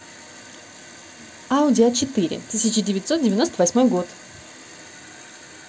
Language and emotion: Russian, neutral